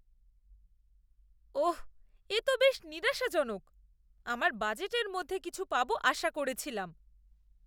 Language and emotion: Bengali, disgusted